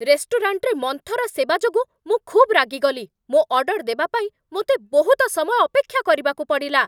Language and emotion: Odia, angry